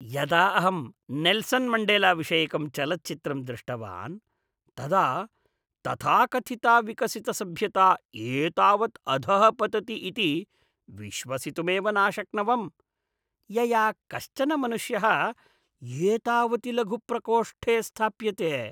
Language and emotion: Sanskrit, disgusted